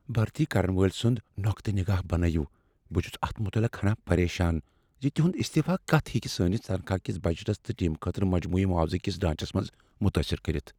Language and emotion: Kashmiri, fearful